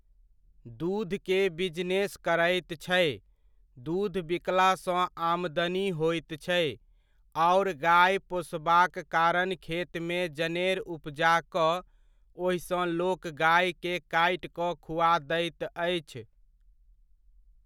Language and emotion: Maithili, neutral